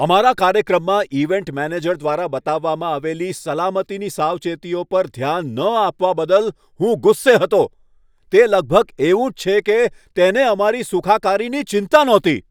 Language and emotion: Gujarati, angry